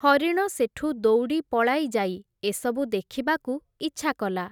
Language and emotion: Odia, neutral